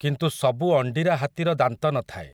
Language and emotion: Odia, neutral